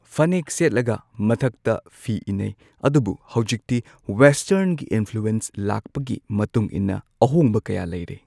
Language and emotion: Manipuri, neutral